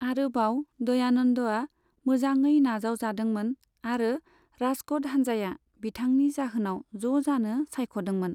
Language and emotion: Bodo, neutral